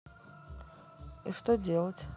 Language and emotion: Russian, neutral